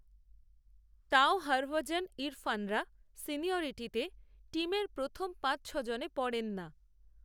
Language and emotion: Bengali, neutral